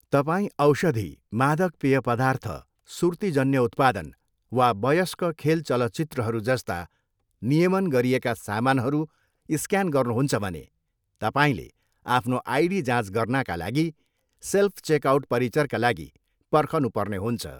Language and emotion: Nepali, neutral